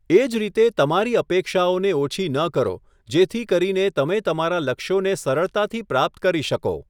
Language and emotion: Gujarati, neutral